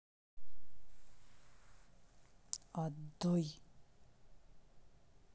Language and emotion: Russian, angry